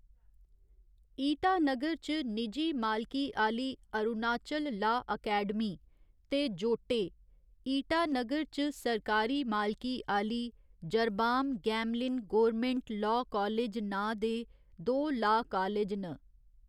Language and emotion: Dogri, neutral